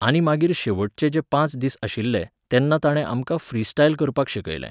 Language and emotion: Goan Konkani, neutral